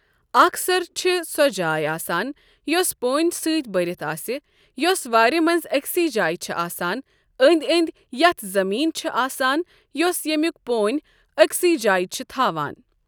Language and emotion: Kashmiri, neutral